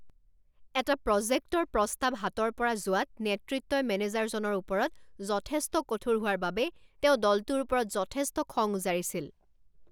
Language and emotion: Assamese, angry